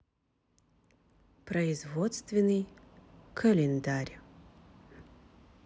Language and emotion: Russian, neutral